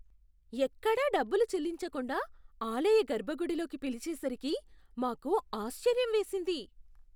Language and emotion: Telugu, surprised